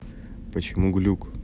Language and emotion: Russian, neutral